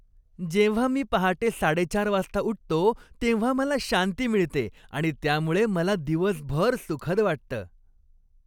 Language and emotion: Marathi, happy